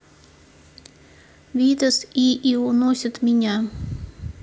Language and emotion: Russian, neutral